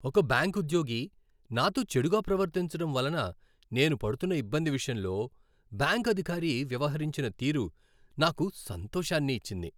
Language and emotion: Telugu, happy